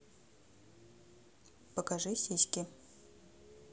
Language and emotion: Russian, neutral